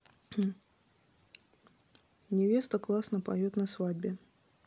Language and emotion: Russian, neutral